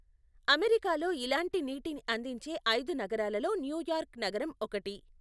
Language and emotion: Telugu, neutral